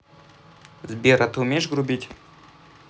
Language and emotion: Russian, neutral